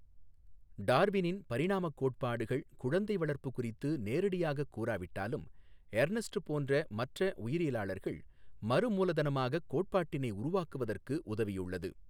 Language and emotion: Tamil, neutral